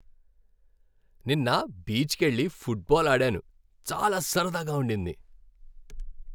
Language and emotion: Telugu, happy